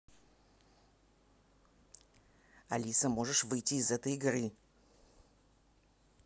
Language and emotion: Russian, angry